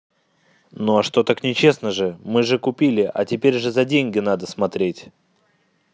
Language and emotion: Russian, angry